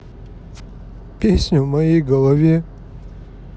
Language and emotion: Russian, sad